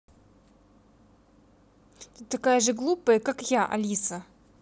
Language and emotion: Russian, angry